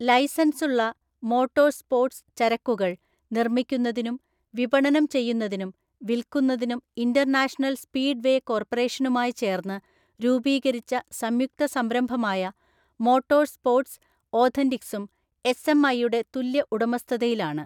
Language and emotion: Malayalam, neutral